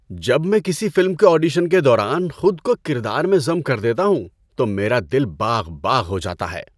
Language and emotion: Urdu, happy